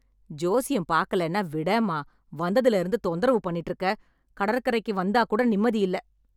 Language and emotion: Tamil, angry